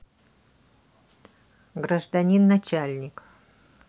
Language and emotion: Russian, neutral